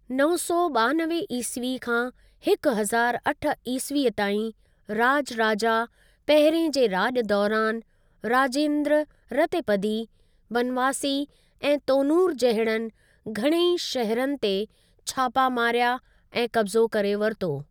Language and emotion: Sindhi, neutral